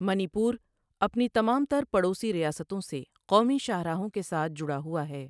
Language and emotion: Urdu, neutral